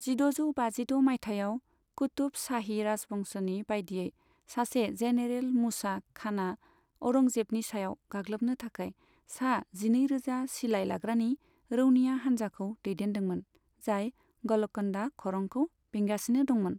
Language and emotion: Bodo, neutral